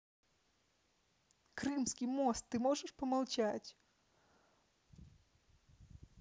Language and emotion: Russian, neutral